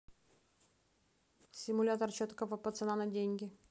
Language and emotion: Russian, neutral